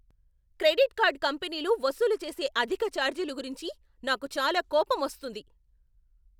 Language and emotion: Telugu, angry